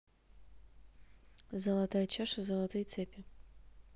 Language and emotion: Russian, neutral